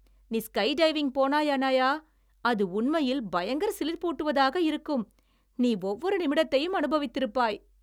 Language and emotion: Tamil, happy